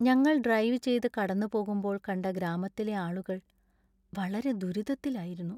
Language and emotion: Malayalam, sad